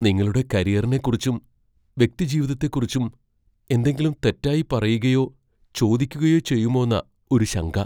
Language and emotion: Malayalam, fearful